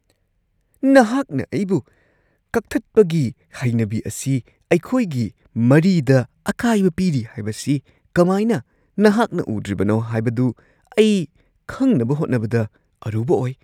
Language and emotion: Manipuri, surprised